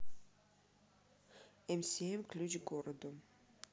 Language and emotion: Russian, neutral